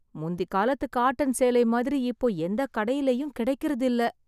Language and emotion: Tamil, sad